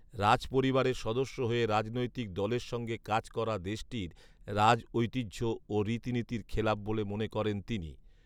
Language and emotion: Bengali, neutral